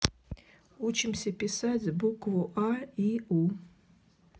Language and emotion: Russian, neutral